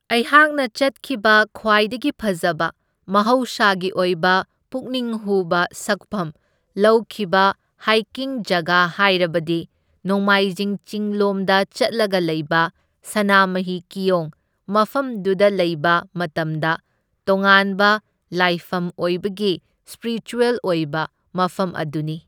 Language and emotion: Manipuri, neutral